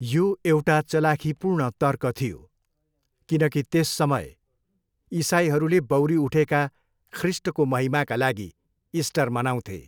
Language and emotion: Nepali, neutral